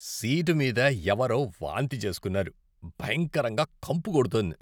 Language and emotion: Telugu, disgusted